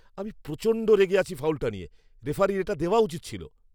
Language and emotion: Bengali, angry